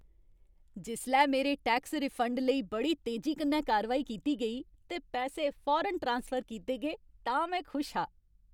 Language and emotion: Dogri, happy